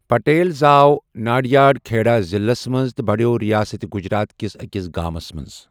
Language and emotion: Kashmiri, neutral